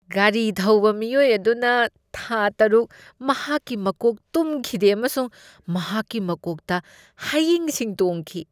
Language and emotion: Manipuri, disgusted